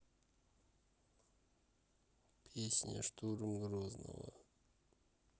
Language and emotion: Russian, sad